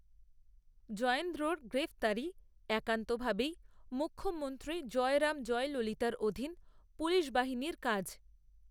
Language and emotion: Bengali, neutral